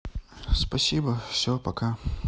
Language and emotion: Russian, neutral